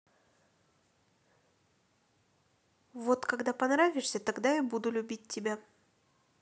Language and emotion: Russian, neutral